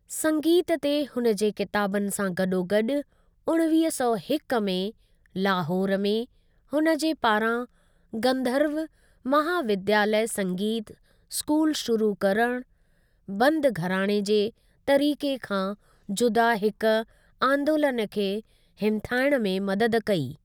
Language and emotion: Sindhi, neutral